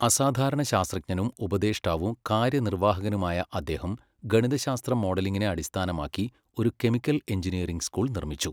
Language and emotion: Malayalam, neutral